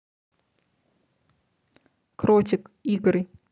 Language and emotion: Russian, neutral